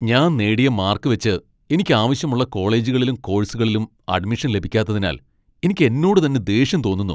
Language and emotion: Malayalam, angry